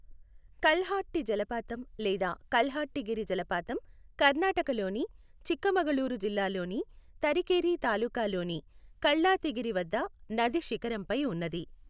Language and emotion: Telugu, neutral